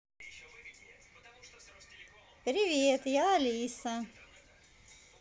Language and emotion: Russian, positive